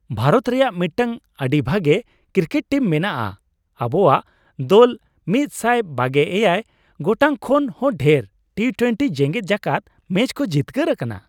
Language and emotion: Santali, happy